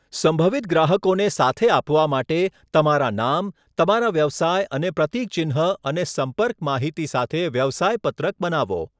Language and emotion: Gujarati, neutral